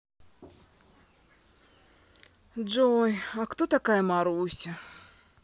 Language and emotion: Russian, sad